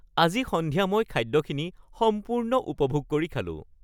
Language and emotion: Assamese, happy